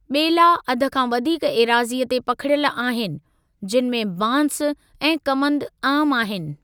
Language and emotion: Sindhi, neutral